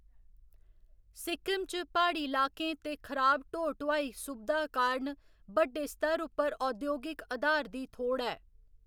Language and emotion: Dogri, neutral